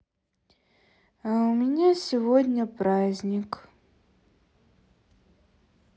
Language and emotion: Russian, sad